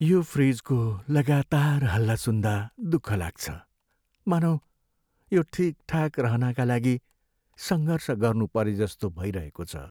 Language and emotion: Nepali, sad